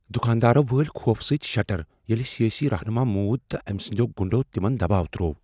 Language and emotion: Kashmiri, fearful